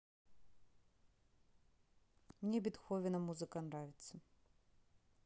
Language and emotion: Russian, neutral